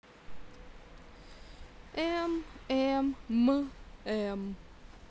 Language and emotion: Russian, sad